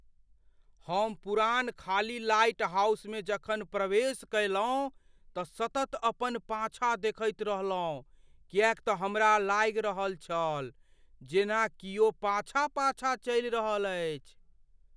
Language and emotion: Maithili, fearful